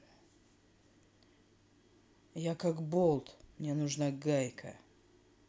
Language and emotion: Russian, angry